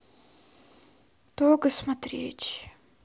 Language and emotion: Russian, sad